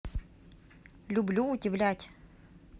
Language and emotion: Russian, neutral